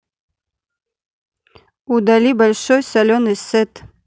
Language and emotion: Russian, neutral